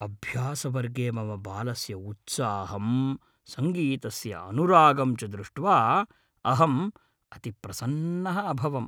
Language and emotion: Sanskrit, happy